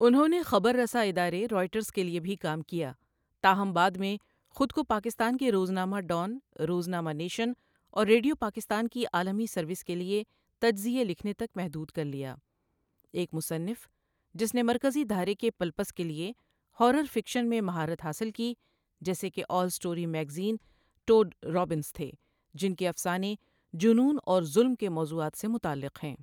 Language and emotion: Urdu, neutral